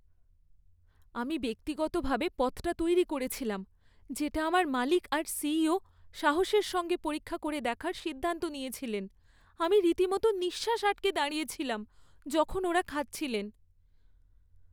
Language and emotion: Bengali, fearful